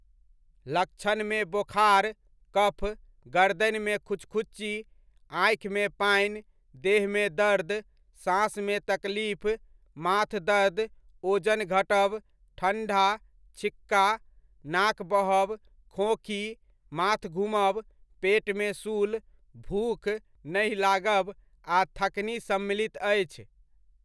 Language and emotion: Maithili, neutral